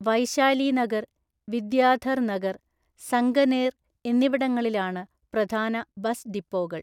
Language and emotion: Malayalam, neutral